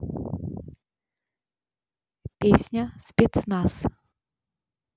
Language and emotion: Russian, neutral